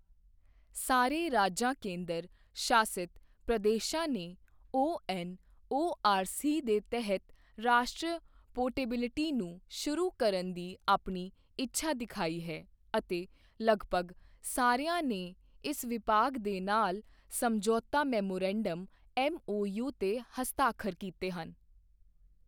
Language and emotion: Punjabi, neutral